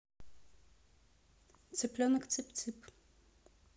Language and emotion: Russian, neutral